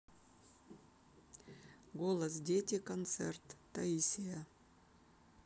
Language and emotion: Russian, neutral